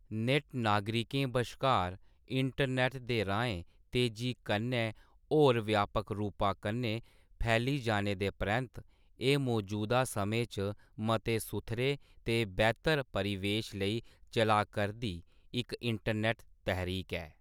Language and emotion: Dogri, neutral